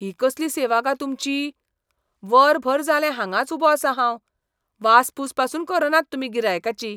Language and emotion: Goan Konkani, disgusted